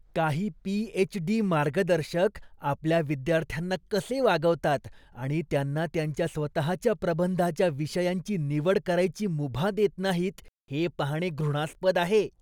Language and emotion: Marathi, disgusted